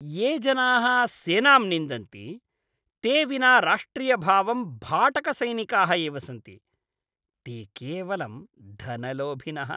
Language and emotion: Sanskrit, disgusted